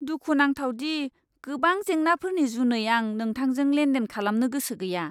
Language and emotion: Bodo, disgusted